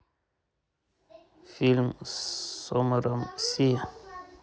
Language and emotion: Russian, neutral